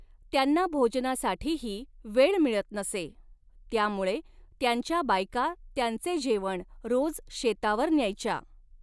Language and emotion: Marathi, neutral